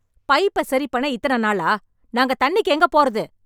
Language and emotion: Tamil, angry